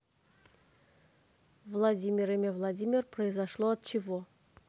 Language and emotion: Russian, neutral